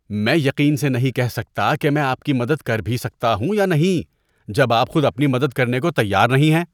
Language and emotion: Urdu, disgusted